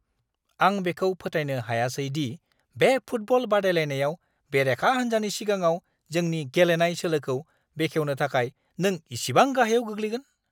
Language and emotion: Bodo, angry